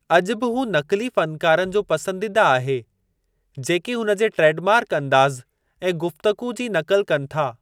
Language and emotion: Sindhi, neutral